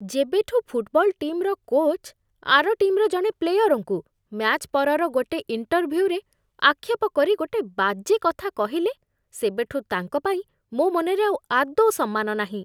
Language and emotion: Odia, disgusted